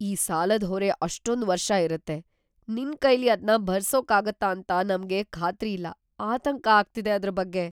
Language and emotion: Kannada, fearful